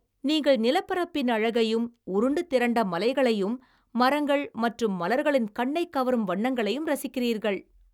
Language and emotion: Tamil, happy